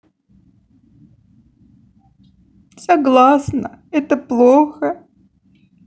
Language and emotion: Russian, sad